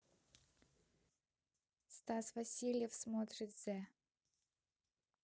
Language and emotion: Russian, neutral